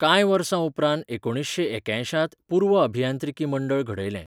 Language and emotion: Goan Konkani, neutral